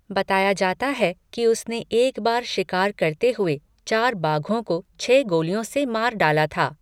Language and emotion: Hindi, neutral